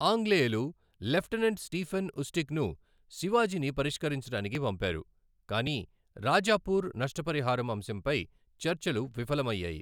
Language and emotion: Telugu, neutral